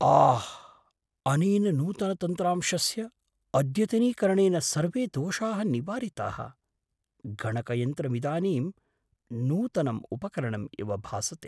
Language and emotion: Sanskrit, surprised